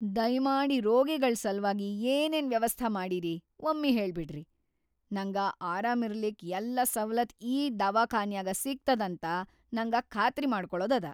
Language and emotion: Kannada, fearful